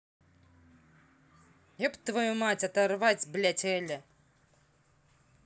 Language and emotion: Russian, angry